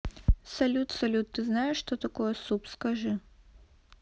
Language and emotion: Russian, neutral